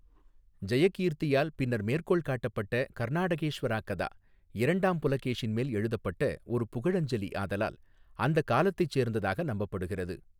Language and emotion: Tamil, neutral